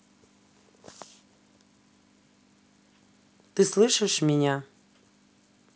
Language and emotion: Russian, neutral